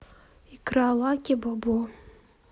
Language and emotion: Russian, sad